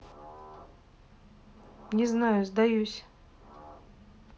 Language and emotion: Russian, neutral